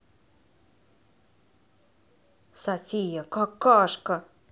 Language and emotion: Russian, angry